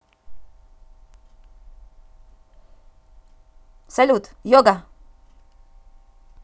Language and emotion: Russian, positive